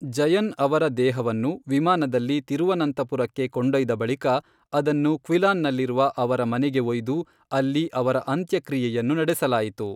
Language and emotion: Kannada, neutral